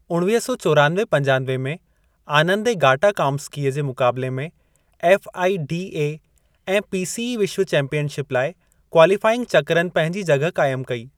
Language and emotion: Sindhi, neutral